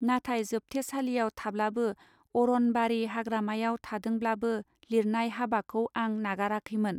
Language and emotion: Bodo, neutral